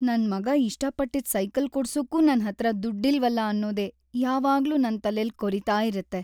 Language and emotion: Kannada, sad